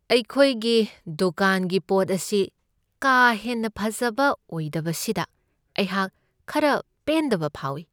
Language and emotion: Manipuri, sad